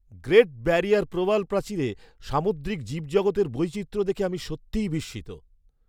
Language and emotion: Bengali, surprised